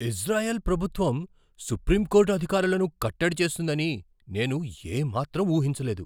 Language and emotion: Telugu, surprised